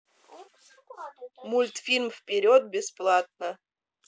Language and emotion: Russian, neutral